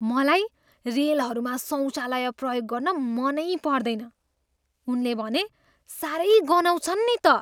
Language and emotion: Nepali, disgusted